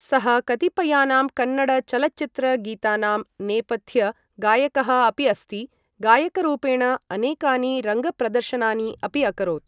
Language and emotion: Sanskrit, neutral